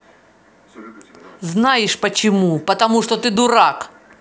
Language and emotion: Russian, angry